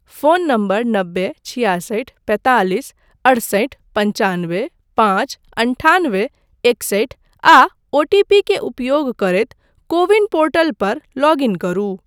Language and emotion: Maithili, neutral